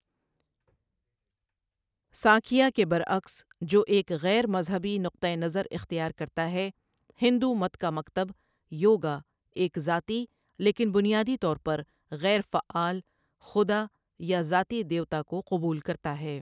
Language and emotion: Urdu, neutral